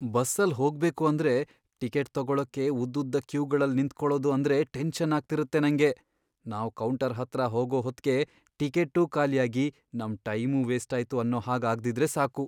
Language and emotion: Kannada, fearful